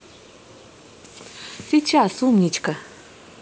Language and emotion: Russian, positive